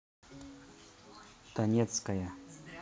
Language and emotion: Russian, neutral